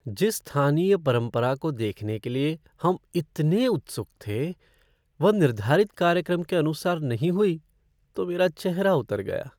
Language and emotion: Hindi, sad